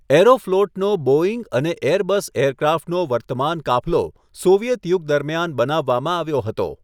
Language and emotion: Gujarati, neutral